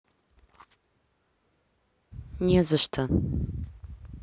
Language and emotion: Russian, neutral